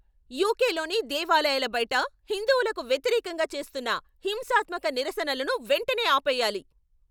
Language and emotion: Telugu, angry